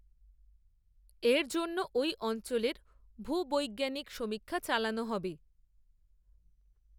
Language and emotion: Bengali, neutral